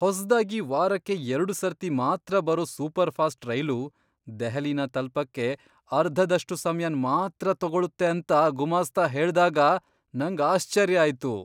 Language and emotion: Kannada, surprised